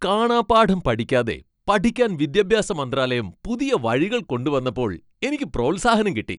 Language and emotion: Malayalam, happy